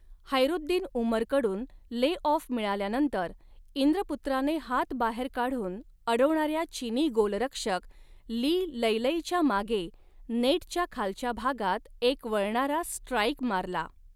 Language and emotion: Marathi, neutral